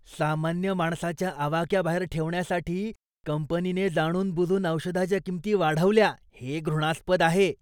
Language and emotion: Marathi, disgusted